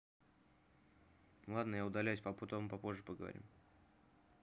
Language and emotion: Russian, neutral